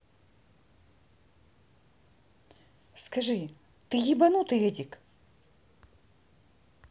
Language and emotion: Russian, angry